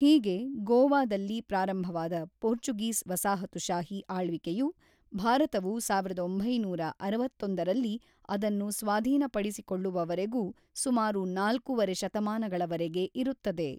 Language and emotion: Kannada, neutral